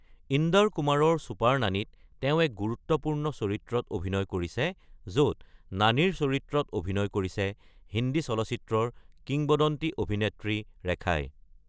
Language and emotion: Assamese, neutral